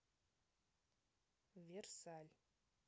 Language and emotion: Russian, neutral